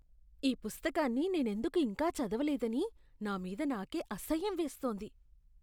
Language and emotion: Telugu, disgusted